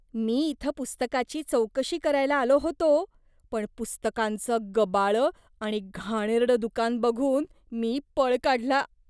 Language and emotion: Marathi, disgusted